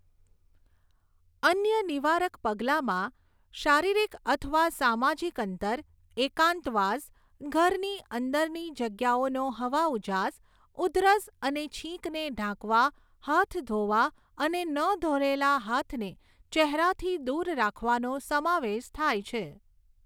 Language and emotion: Gujarati, neutral